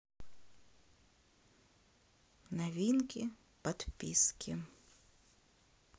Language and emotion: Russian, neutral